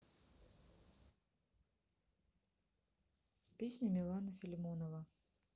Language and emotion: Russian, neutral